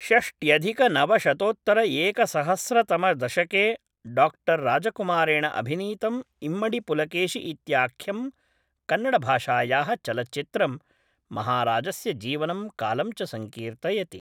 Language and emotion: Sanskrit, neutral